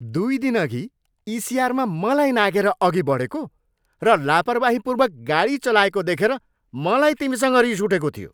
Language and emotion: Nepali, angry